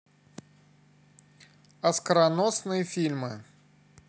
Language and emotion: Russian, neutral